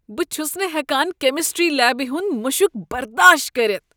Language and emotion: Kashmiri, disgusted